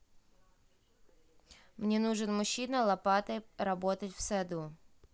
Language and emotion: Russian, neutral